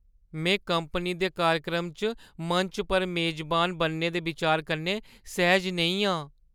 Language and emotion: Dogri, fearful